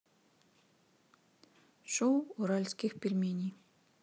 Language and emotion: Russian, neutral